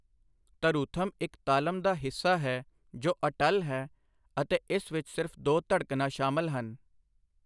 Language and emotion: Punjabi, neutral